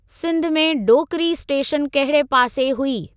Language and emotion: Sindhi, neutral